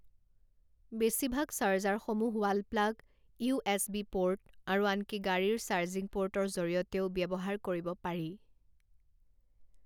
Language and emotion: Assamese, neutral